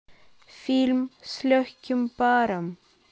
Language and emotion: Russian, neutral